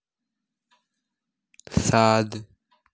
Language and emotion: Russian, neutral